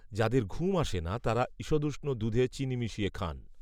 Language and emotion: Bengali, neutral